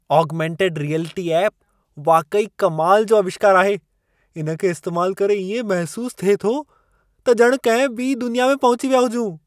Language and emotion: Sindhi, surprised